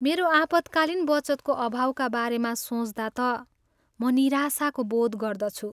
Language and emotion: Nepali, sad